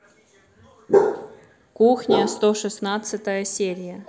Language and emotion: Russian, neutral